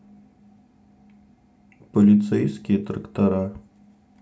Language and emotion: Russian, sad